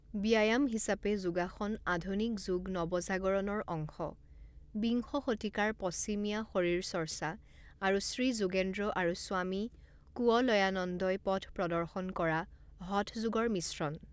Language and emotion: Assamese, neutral